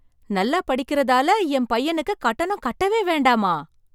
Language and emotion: Tamil, surprised